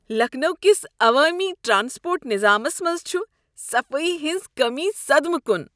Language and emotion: Kashmiri, disgusted